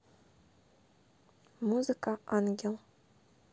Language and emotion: Russian, neutral